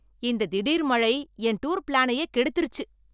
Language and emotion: Tamil, angry